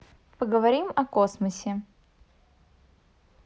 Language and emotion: Russian, neutral